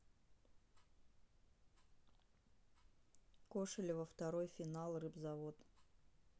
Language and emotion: Russian, sad